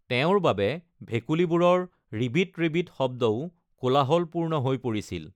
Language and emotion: Assamese, neutral